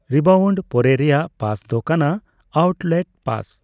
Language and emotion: Santali, neutral